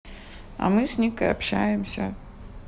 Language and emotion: Russian, neutral